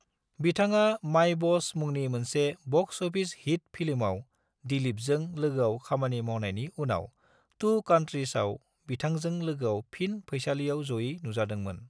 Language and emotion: Bodo, neutral